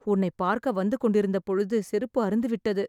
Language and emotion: Tamil, sad